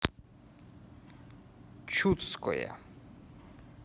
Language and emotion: Russian, neutral